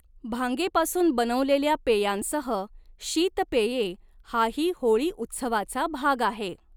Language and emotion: Marathi, neutral